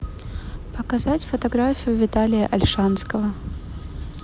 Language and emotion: Russian, neutral